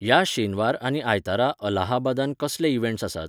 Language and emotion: Goan Konkani, neutral